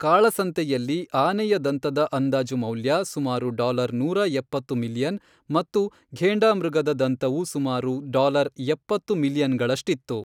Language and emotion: Kannada, neutral